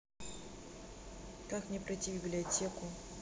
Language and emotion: Russian, neutral